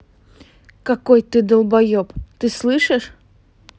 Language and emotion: Russian, angry